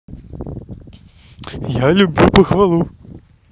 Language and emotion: Russian, positive